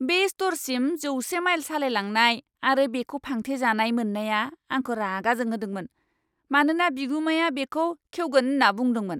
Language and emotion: Bodo, angry